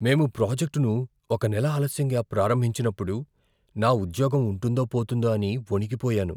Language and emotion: Telugu, fearful